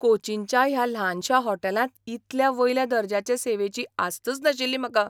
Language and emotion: Goan Konkani, surprised